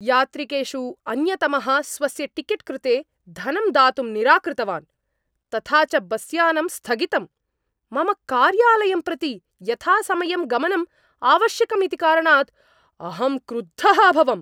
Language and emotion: Sanskrit, angry